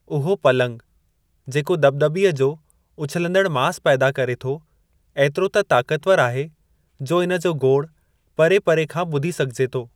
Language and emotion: Sindhi, neutral